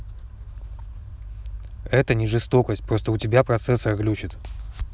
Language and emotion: Russian, neutral